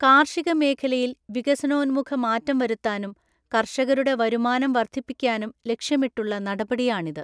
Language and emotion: Malayalam, neutral